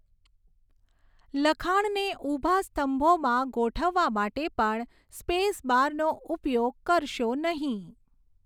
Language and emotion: Gujarati, neutral